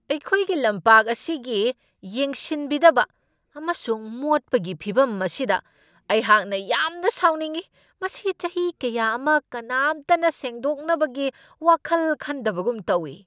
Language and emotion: Manipuri, angry